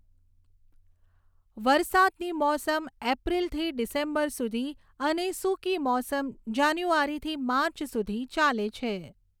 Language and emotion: Gujarati, neutral